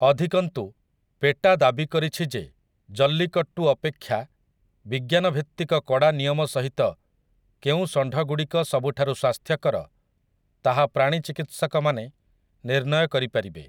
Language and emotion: Odia, neutral